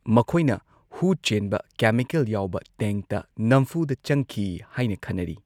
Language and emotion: Manipuri, neutral